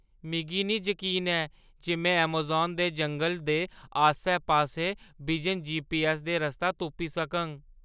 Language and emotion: Dogri, fearful